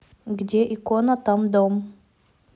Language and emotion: Russian, neutral